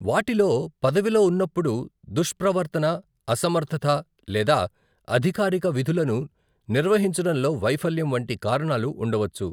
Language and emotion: Telugu, neutral